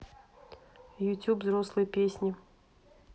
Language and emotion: Russian, neutral